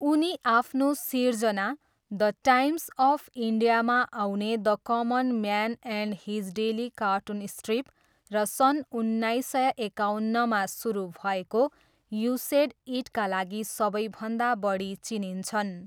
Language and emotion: Nepali, neutral